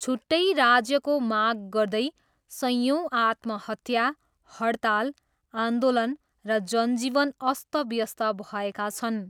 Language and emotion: Nepali, neutral